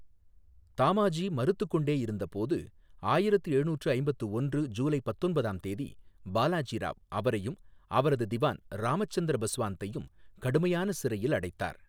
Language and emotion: Tamil, neutral